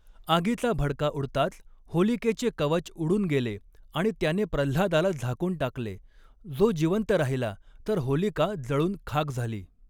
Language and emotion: Marathi, neutral